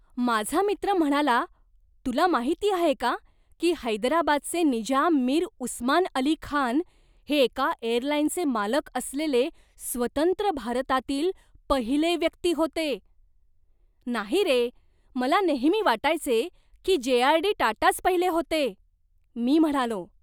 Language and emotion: Marathi, surprised